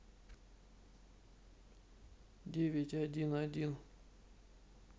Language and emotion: Russian, neutral